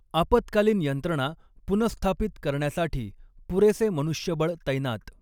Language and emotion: Marathi, neutral